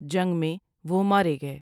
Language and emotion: Urdu, neutral